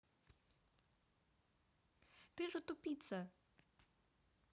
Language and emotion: Russian, angry